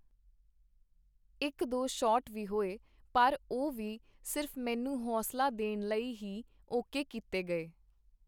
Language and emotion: Punjabi, neutral